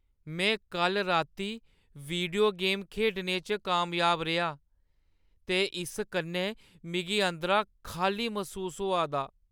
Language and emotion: Dogri, sad